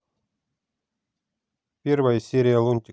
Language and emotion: Russian, neutral